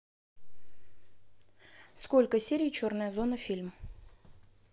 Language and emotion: Russian, neutral